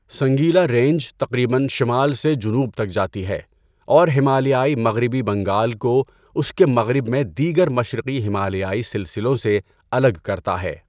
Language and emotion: Urdu, neutral